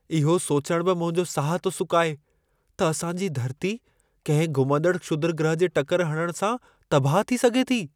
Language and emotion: Sindhi, fearful